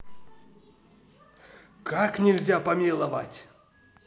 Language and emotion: Russian, angry